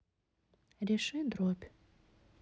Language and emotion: Russian, neutral